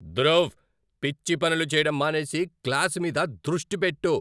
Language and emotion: Telugu, angry